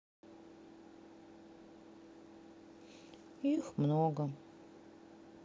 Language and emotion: Russian, sad